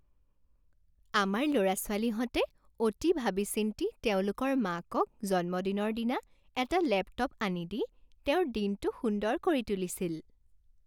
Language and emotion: Assamese, happy